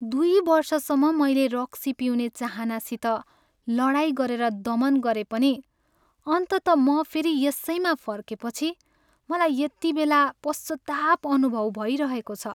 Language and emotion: Nepali, sad